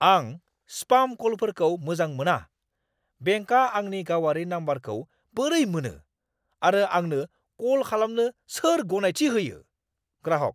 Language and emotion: Bodo, angry